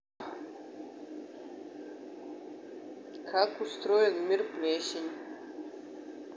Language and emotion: Russian, neutral